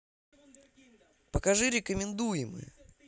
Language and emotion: Russian, positive